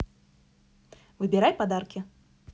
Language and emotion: Russian, positive